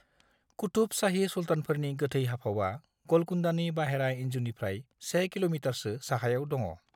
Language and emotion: Bodo, neutral